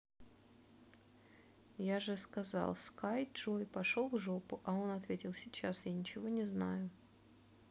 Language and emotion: Russian, neutral